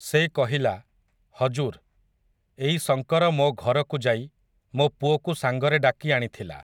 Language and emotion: Odia, neutral